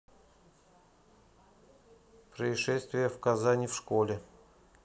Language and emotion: Russian, neutral